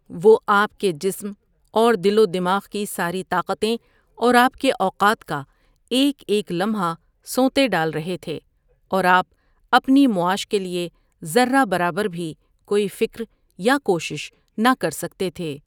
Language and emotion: Urdu, neutral